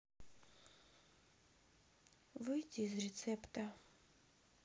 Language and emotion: Russian, sad